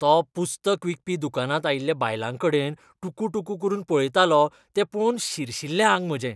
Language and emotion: Goan Konkani, disgusted